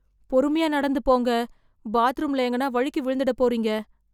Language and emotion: Tamil, fearful